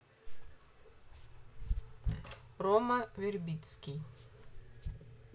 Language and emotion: Russian, neutral